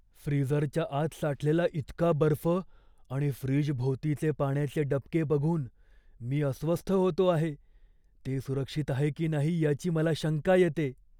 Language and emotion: Marathi, fearful